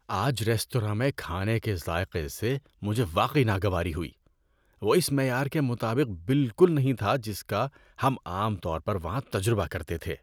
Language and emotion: Urdu, disgusted